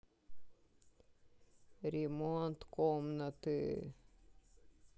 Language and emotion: Russian, sad